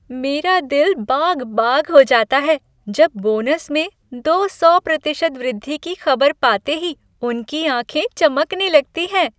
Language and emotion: Hindi, happy